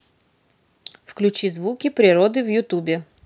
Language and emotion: Russian, neutral